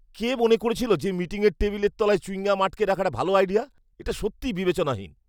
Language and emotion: Bengali, disgusted